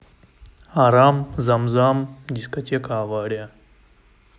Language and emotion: Russian, neutral